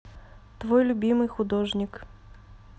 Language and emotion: Russian, neutral